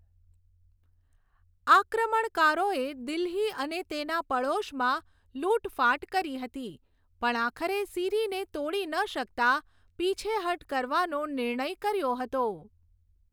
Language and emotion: Gujarati, neutral